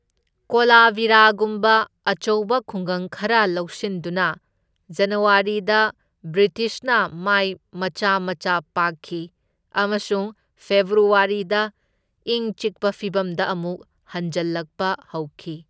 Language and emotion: Manipuri, neutral